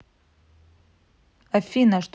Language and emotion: Russian, neutral